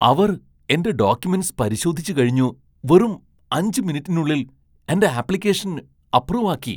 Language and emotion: Malayalam, surprised